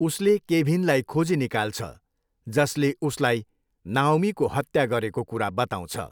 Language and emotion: Nepali, neutral